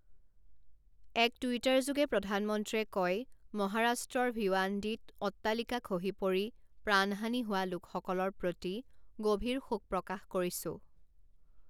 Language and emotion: Assamese, neutral